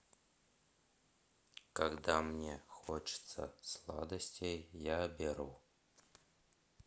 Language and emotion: Russian, neutral